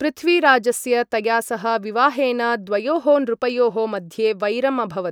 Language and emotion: Sanskrit, neutral